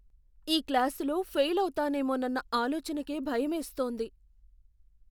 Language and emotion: Telugu, fearful